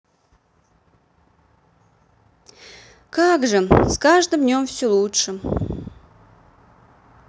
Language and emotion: Russian, sad